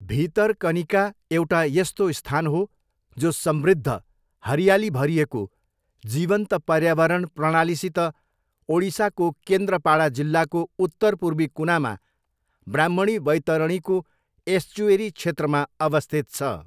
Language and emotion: Nepali, neutral